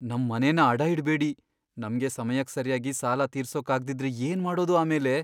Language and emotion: Kannada, fearful